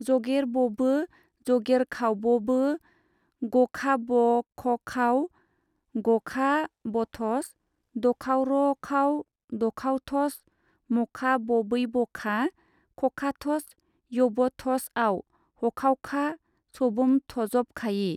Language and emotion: Bodo, neutral